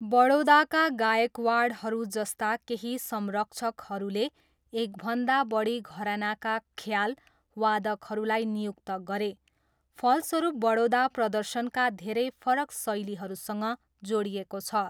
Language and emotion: Nepali, neutral